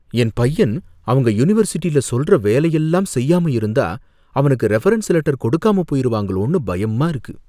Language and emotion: Tamil, fearful